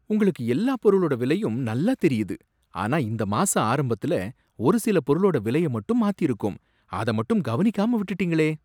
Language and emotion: Tamil, surprised